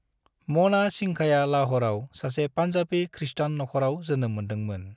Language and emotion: Bodo, neutral